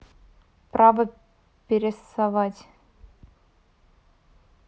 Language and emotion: Russian, neutral